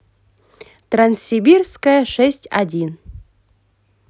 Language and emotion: Russian, positive